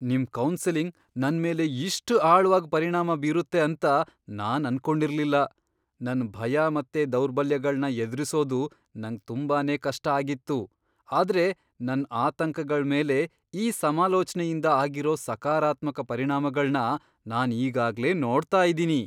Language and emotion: Kannada, surprised